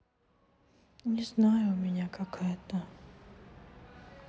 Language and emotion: Russian, sad